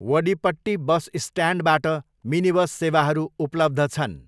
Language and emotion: Nepali, neutral